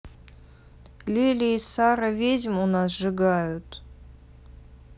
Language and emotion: Russian, neutral